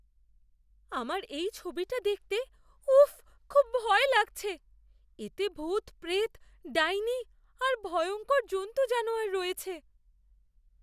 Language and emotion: Bengali, fearful